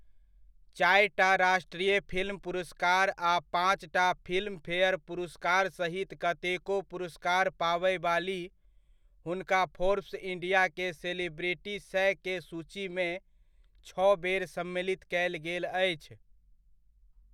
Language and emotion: Maithili, neutral